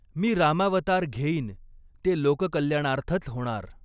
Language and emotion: Marathi, neutral